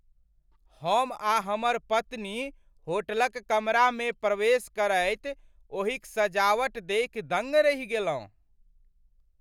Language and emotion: Maithili, surprised